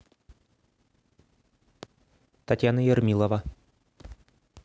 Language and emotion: Russian, neutral